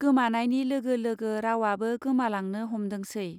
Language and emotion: Bodo, neutral